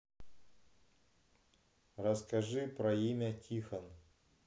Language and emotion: Russian, neutral